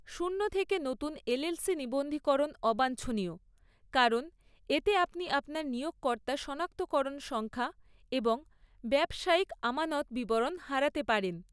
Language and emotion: Bengali, neutral